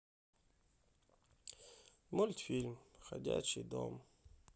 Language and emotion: Russian, sad